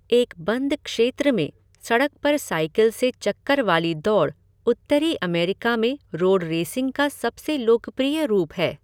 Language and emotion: Hindi, neutral